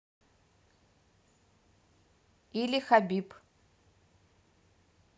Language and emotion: Russian, neutral